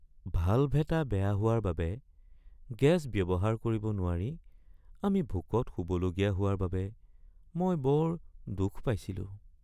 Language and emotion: Assamese, sad